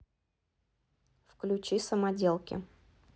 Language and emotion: Russian, neutral